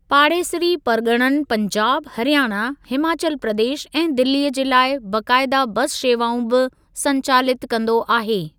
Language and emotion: Sindhi, neutral